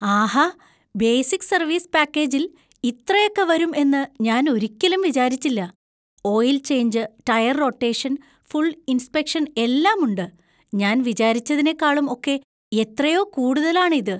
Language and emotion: Malayalam, surprised